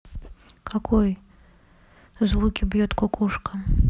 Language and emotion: Russian, neutral